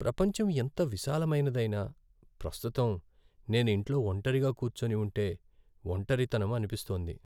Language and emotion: Telugu, sad